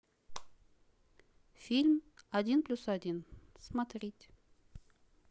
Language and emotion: Russian, neutral